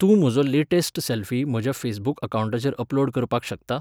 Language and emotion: Goan Konkani, neutral